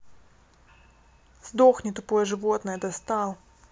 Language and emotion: Russian, angry